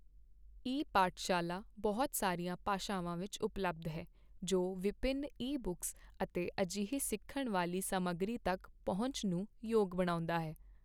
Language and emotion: Punjabi, neutral